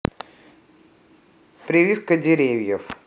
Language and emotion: Russian, neutral